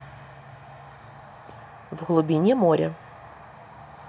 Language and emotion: Russian, neutral